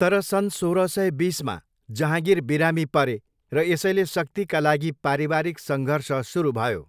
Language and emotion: Nepali, neutral